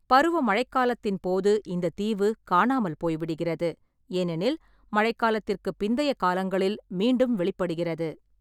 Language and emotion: Tamil, neutral